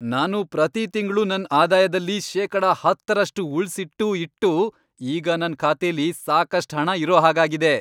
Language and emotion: Kannada, happy